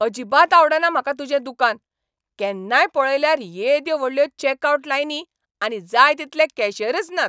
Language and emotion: Goan Konkani, angry